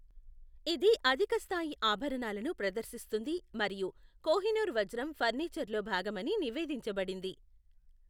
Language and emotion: Telugu, neutral